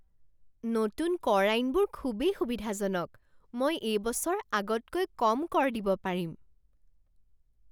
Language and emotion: Assamese, surprised